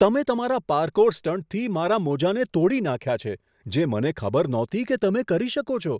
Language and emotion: Gujarati, surprised